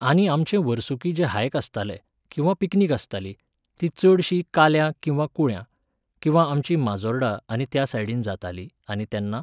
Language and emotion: Goan Konkani, neutral